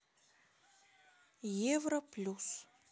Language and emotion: Russian, neutral